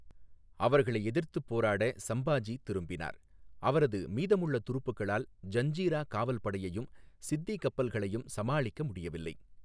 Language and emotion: Tamil, neutral